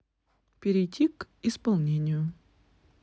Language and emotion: Russian, neutral